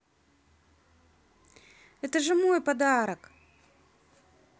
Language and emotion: Russian, positive